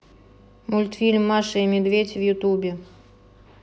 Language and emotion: Russian, neutral